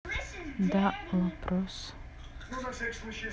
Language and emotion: Russian, neutral